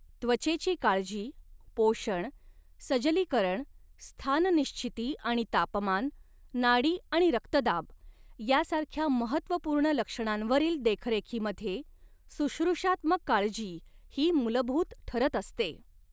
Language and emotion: Marathi, neutral